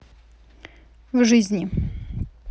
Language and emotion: Russian, neutral